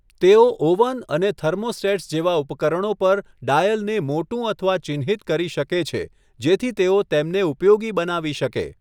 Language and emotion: Gujarati, neutral